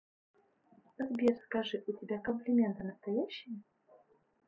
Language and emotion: Russian, neutral